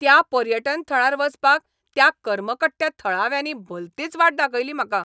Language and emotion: Goan Konkani, angry